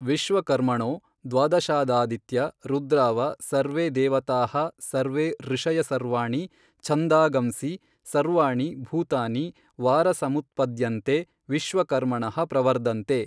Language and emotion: Kannada, neutral